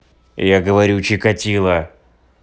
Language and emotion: Russian, angry